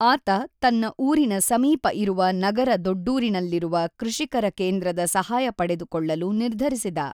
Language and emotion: Kannada, neutral